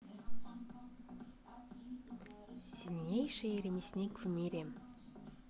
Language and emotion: Russian, neutral